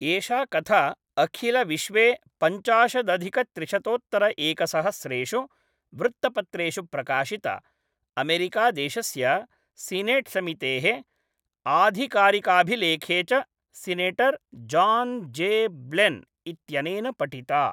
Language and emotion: Sanskrit, neutral